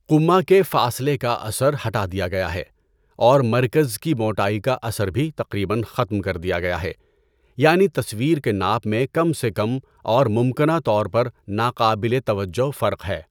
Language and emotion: Urdu, neutral